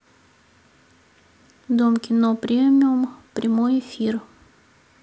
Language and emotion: Russian, neutral